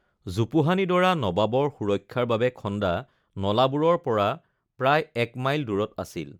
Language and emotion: Assamese, neutral